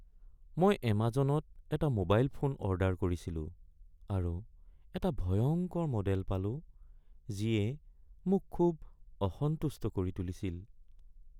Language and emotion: Assamese, sad